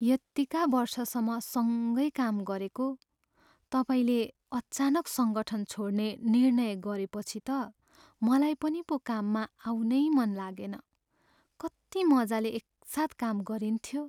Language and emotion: Nepali, sad